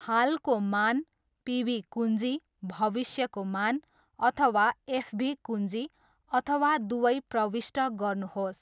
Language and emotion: Nepali, neutral